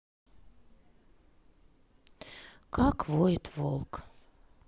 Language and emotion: Russian, sad